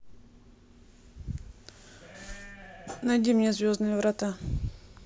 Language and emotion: Russian, neutral